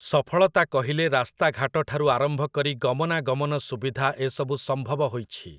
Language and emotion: Odia, neutral